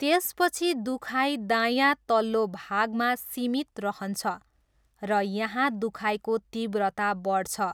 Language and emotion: Nepali, neutral